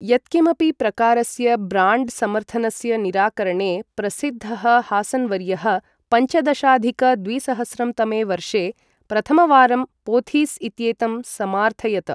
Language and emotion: Sanskrit, neutral